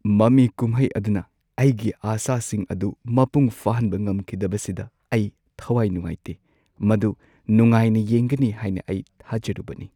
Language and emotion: Manipuri, sad